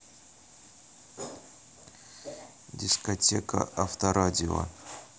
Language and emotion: Russian, neutral